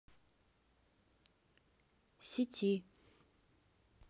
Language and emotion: Russian, neutral